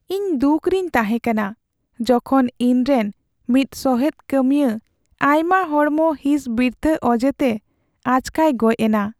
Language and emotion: Santali, sad